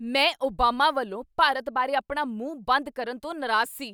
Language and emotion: Punjabi, angry